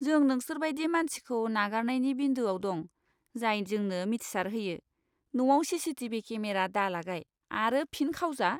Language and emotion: Bodo, disgusted